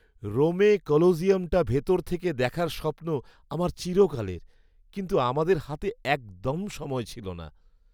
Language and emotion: Bengali, sad